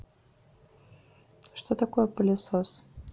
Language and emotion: Russian, neutral